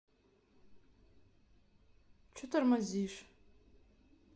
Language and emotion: Russian, angry